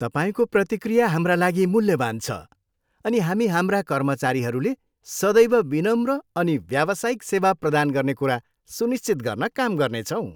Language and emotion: Nepali, happy